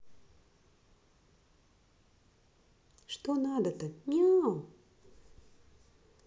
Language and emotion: Russian, sad